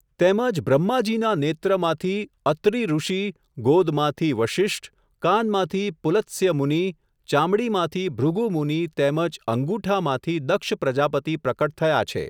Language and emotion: Gujarati, neutral